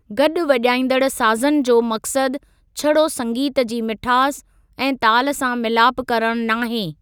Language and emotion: Sindhi, neutral